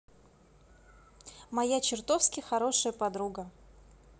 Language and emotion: Russian, positive